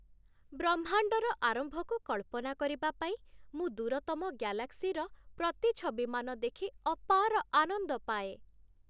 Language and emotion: Odia, happy